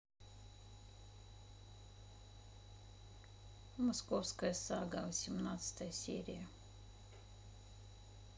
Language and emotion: Russian, neutral